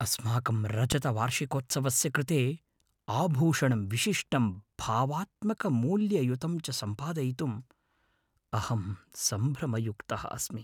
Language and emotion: Sanskrit, fearful